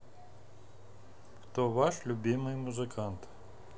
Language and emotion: Russian, neutral